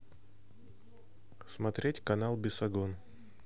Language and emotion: Russian, neutral